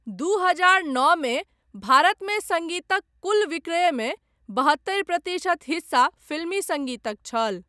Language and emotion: Maithili, neutral